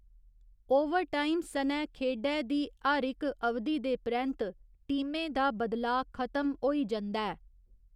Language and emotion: Dogri, neutral